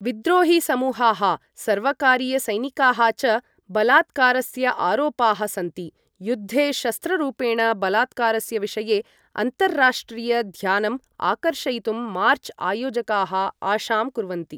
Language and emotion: Sanskrit, neutral